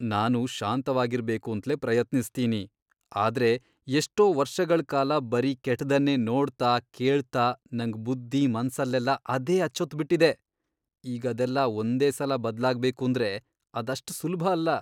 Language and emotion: Kannada, disgusted